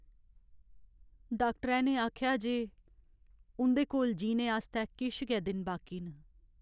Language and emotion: Dogri, sad